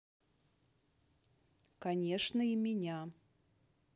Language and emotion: Russian, neutral